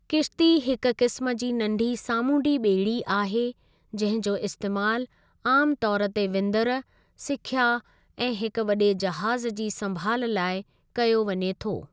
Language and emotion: Sindhi, neutral